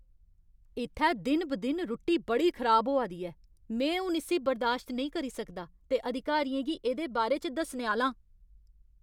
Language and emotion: Dogri, angry